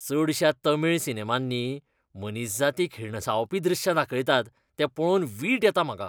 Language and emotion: Goan Konkani, disgusted